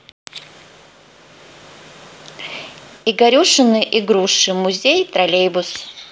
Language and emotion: Russian, neutral